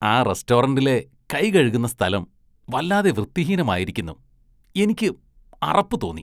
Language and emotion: Malayalam, disgusted